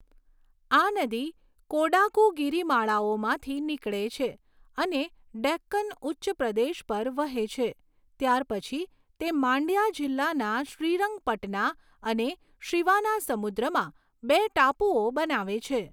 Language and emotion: Gujarati, neutral